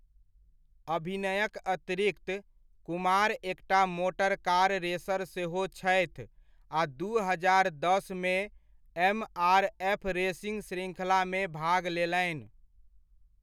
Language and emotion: Maithili, neutral